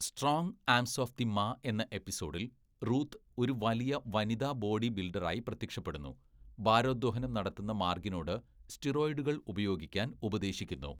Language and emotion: Malayalam, neutral